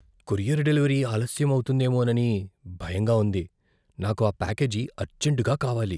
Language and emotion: Telugu, fearful